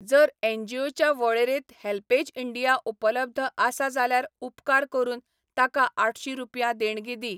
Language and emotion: Goan Konkani, neutral